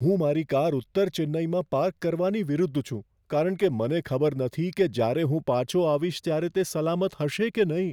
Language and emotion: Gujarati, fearful